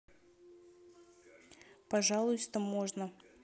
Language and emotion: Russian, neutral